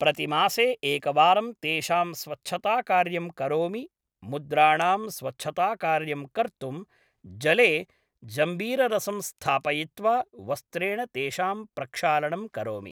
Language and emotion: Sanskrit, neutral